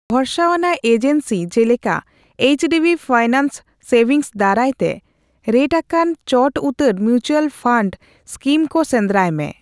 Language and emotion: Santali, neutral